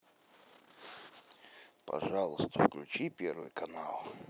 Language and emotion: Russian, neutral